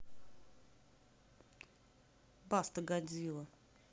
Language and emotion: Russian, neutral